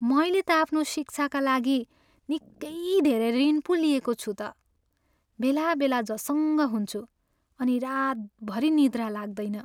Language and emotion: Nepali, sad